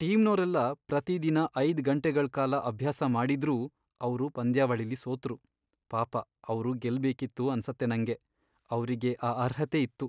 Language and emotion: Kannada, sad